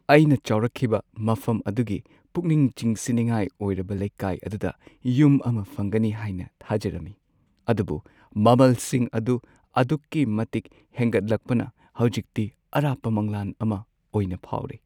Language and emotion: Manipuri, sad